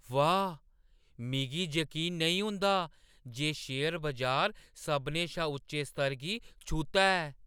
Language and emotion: Dogri, surprised